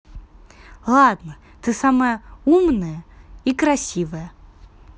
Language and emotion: Russian, positive